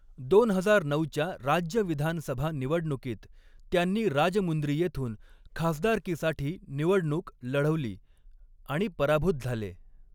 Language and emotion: Marathi, neutral